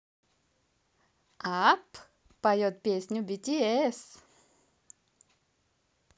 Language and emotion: Russian, positive